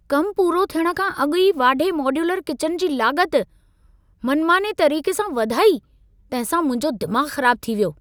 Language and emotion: Sindhi, angry